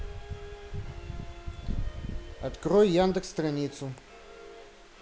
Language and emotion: Russian, neutral